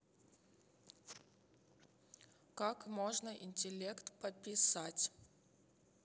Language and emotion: Russian, neutral